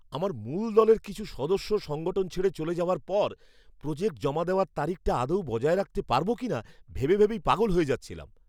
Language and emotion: Bengali, fearful